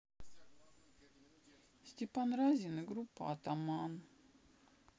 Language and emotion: Russian, sad